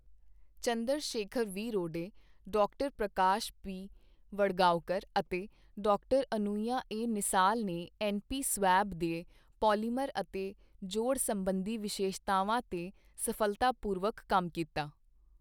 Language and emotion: Punjabi, neutral